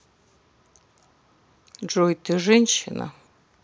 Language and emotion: Russian, neutral